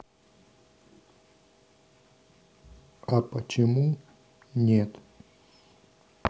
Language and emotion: Russian, sad